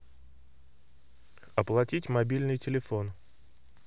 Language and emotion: Russian, neutral